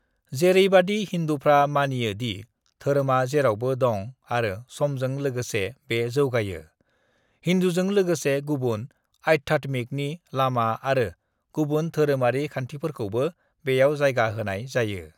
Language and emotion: Bodo, neutral